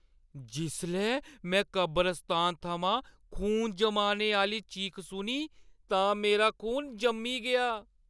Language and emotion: Dogri, fearful